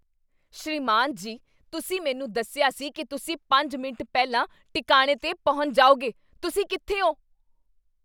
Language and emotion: Punjabi, angry